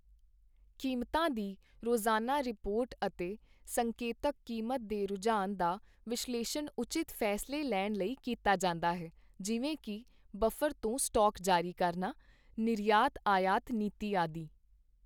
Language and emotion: Punjabi, neutral